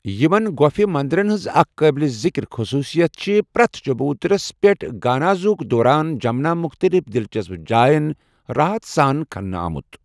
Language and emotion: Kashmiri, neutral